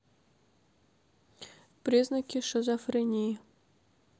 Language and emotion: Russian, neutral